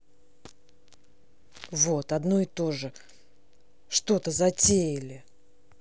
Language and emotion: Russian, angry